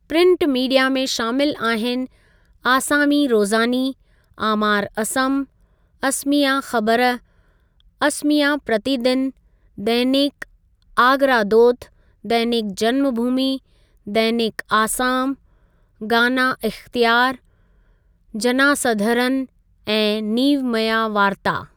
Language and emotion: Sindhi, neutral